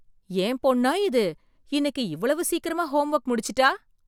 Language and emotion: Tamil, surprised